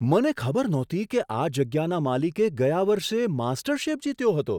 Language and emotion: Gujarati, surprised